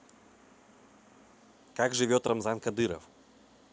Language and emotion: Russian, neutral